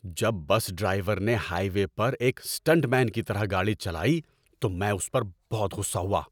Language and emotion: Urdu, angry